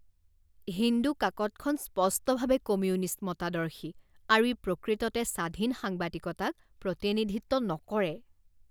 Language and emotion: Assamese, disgusted